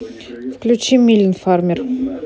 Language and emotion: Russian, neutral